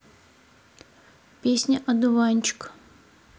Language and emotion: Russian, neutral